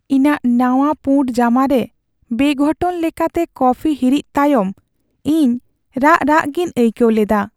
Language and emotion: Santali, sad